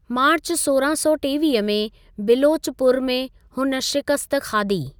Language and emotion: Sindhi, neutral